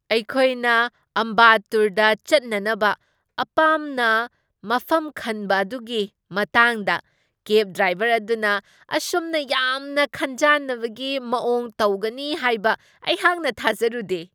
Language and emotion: Manipuri, surprised